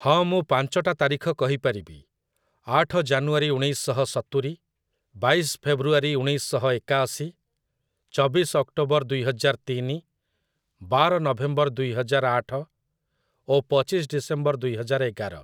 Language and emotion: Odia, neutral